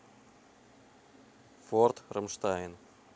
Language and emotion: Russian, neutral